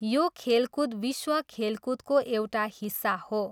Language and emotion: Nepali, neutral